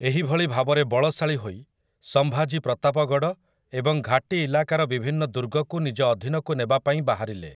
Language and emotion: Odia, neutral